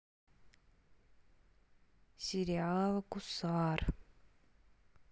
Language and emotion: Russian, sad